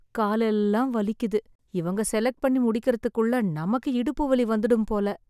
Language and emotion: Tamil, sad